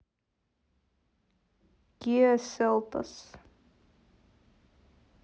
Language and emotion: Russian, neutral